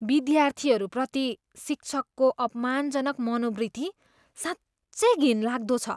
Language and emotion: Nepali, disgusted